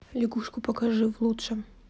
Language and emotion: Russian, neutral